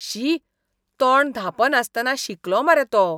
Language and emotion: Goan Konkani, disgusted